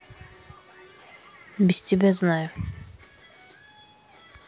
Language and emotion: Russian, angry